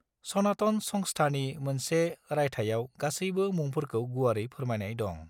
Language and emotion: Bodo, neutral